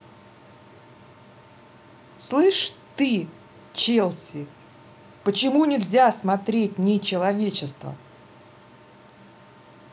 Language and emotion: Russian, angry